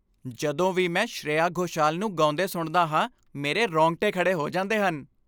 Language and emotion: Punjabi, happy